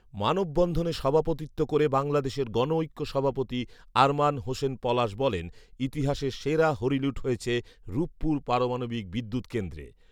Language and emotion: Bengali, neutral